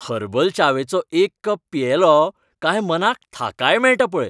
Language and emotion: Goan Konkani, happy